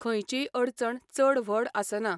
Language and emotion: Goan Konkani, neutral